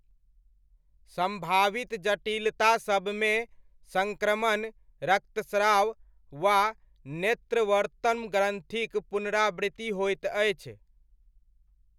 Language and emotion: Maithili, neutral